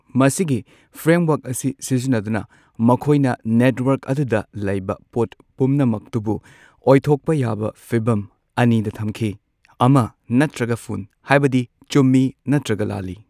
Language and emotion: Manipuri, neutral